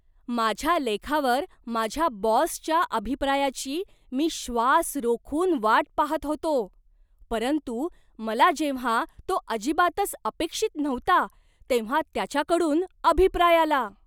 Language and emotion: Marathi, surprised